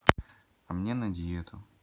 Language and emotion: Russian, neutral